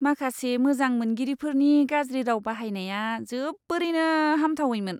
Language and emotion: Bodo, disgusted